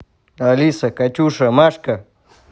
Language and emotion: Russian, neutral